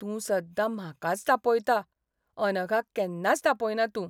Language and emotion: Goan Konkani, sad